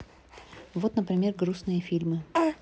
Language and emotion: Russian, neutral